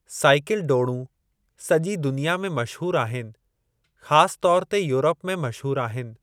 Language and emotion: Sindhi, neutral